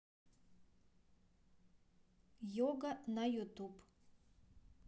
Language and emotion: Russian, neutral